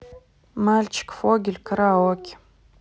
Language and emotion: Russian, neutral